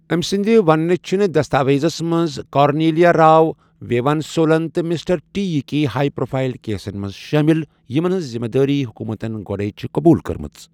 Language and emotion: Kashmiri, neutral